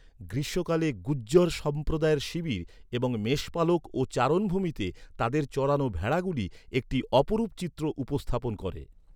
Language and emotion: Bengali, neutral